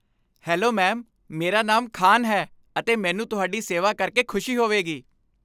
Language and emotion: Punjabi, happy